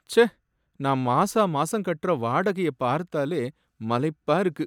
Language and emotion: Tamil, sad